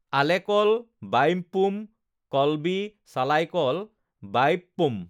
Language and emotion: Assamese, neutral